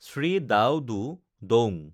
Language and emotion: Assamese, neutral